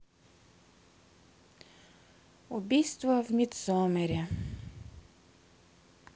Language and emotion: Russian, sad